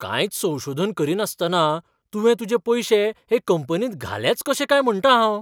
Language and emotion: Goan Konkani, surprised